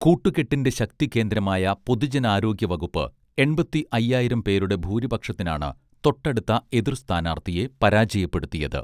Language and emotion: Malayalam, neutral